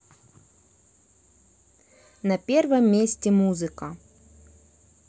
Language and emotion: Russian, neutral